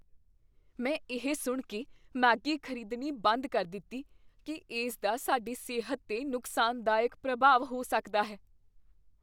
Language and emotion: Punjabi, fearful